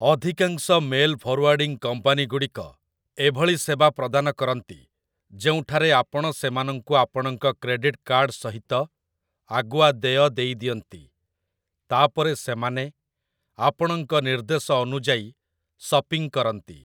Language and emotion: Odia, neutral